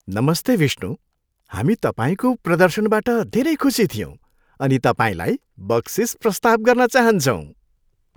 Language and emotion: Nepali, happy